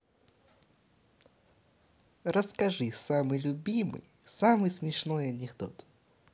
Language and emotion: Russian, positive